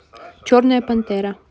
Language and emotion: Russian, neutral